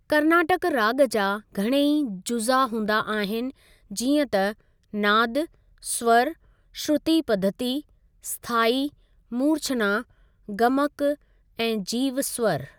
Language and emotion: Sindhi, neutral